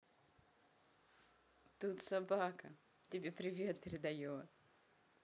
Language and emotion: Russian, positive